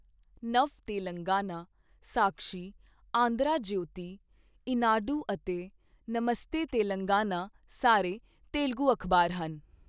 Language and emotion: Punjabi, neutral